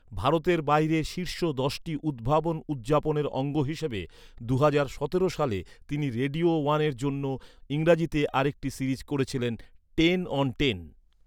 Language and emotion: Bengali, neutral